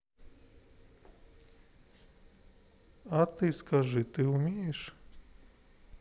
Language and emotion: Russian, neutral